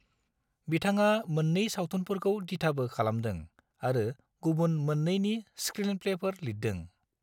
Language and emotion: Bodo, neutral